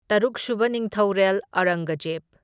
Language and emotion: Manipuri, neutral